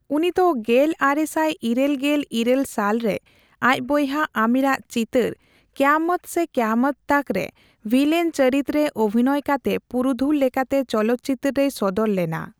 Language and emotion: Santali, neutral